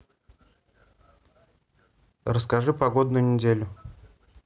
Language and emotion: Russian, neutral